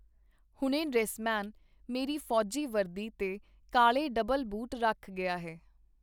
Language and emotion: Punjabi, neutral